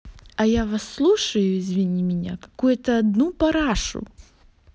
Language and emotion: Russian, angry